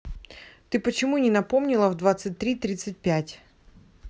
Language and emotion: Russian, angry